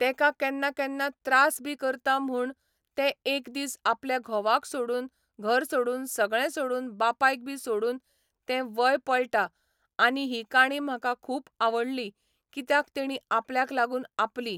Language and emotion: Goan Konkani, neutral